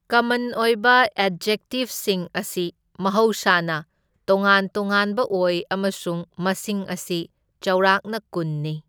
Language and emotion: Manipuri, neutral